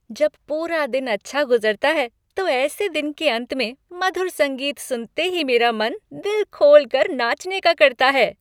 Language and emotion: Hindi, happy